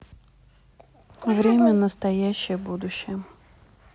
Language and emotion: Russian, neutral